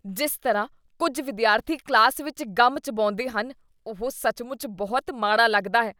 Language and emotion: Punjabi, disgusted